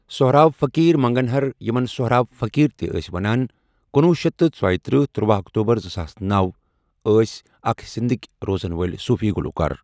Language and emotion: Kashmiri, neutral